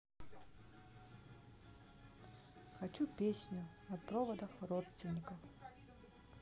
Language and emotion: Russian, sad